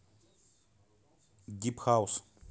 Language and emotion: Russian, neutral